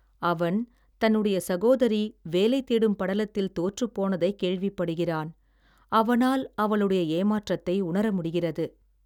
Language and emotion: Tamil, sad